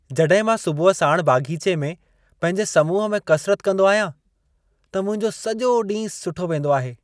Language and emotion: Sindhi, happy